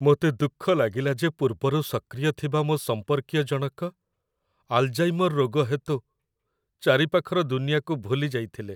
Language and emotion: Odia, sad